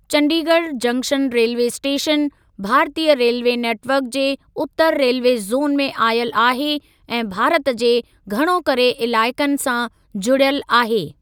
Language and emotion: Sindhi, neutral